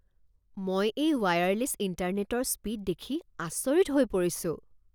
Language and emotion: Assamese, surprised